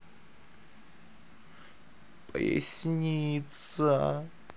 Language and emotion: Russian, sad